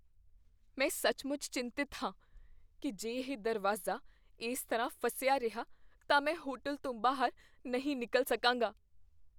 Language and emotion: Punjabi, fearful